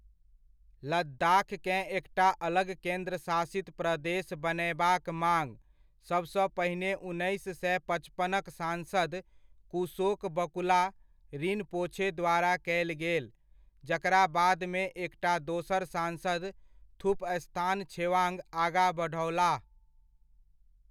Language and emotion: Maithili, neutral